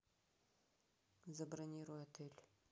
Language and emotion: Russian, neutral